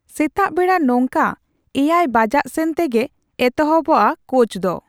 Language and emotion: Santali, neutral